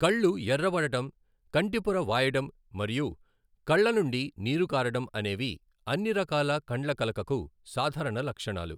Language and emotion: Telugu, neutral